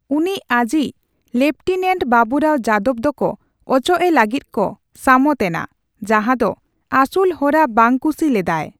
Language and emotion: Santali, neutral